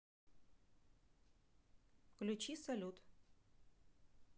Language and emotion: Russian, neutral